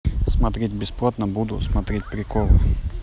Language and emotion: Russian, neutral